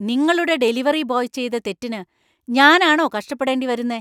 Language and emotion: Malayalam, angry